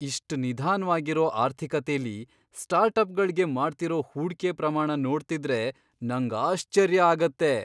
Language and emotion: Kannada, surprised